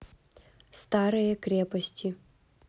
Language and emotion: Russian, neutral